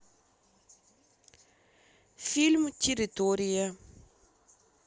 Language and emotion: Russian, neutral